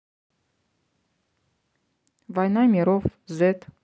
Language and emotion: Russian, neutral